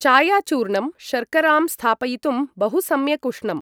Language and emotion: Sanskrit, neutral